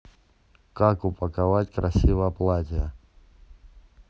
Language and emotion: Russian, neutral